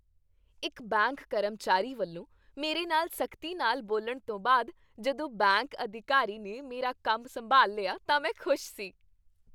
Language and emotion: Punjabi, happy